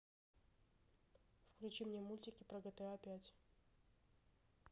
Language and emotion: Russian, neutral